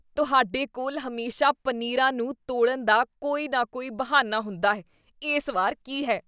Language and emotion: Punjabi, disgusted